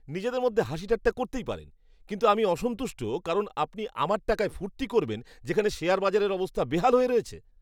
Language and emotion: Bengali, disgusted